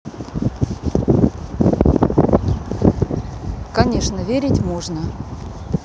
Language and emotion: Russian, neutral